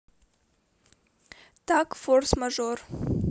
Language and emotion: Russian, neutral